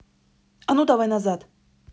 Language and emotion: Russian, angry